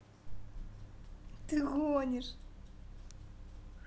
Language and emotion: Russian, positive